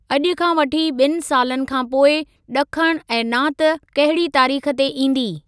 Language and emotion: Sindhi, neutral